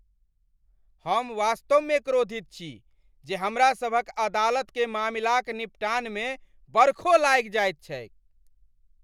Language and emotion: Maithili, angry